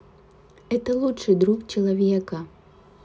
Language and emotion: Russian, sad